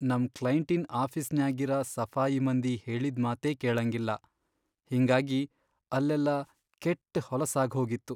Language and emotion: Kannada, sad